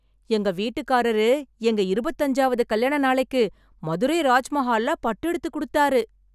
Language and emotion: Tamil, happy